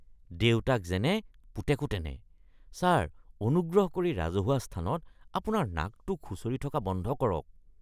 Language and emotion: Assamese, disgusted